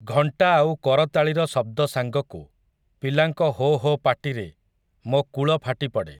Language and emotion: Odia, neutral